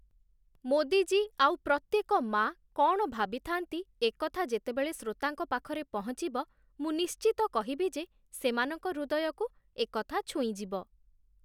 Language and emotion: Odia, neutral